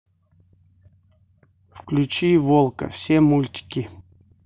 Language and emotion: Russian, neutral